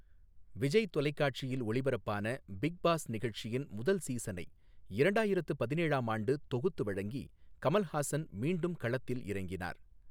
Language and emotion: Tamil, neutral